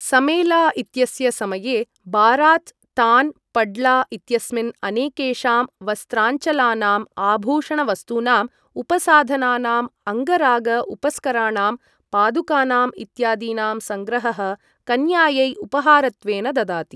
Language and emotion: Sanskrit, neutral